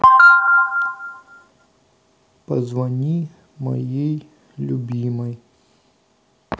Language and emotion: Russian, sad